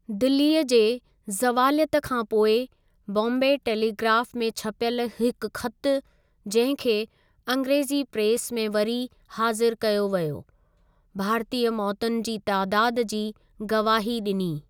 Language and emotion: Sindhi, neutral